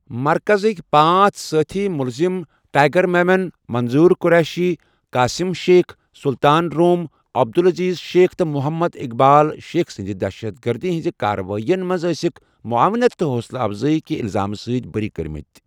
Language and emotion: Kashmiri, neutral